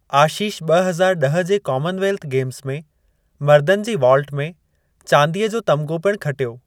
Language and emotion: Sindhi, neutral